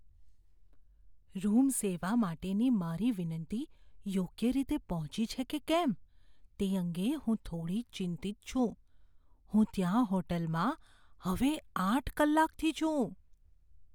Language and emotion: Gujarati, fearful